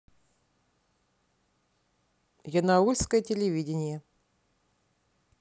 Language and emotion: Russian, neutral